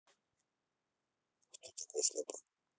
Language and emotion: Russian, neutral